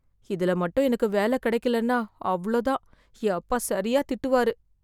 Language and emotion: Tamil, fearful